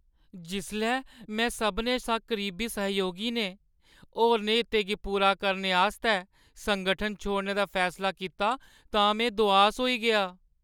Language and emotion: Dogri, sad